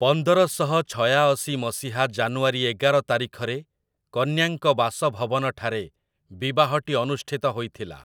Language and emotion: Odia, neutral